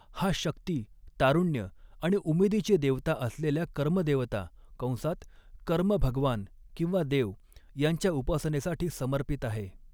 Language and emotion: Marathi, neutral